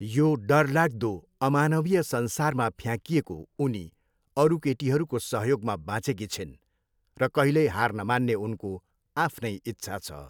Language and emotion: Nepali, neutral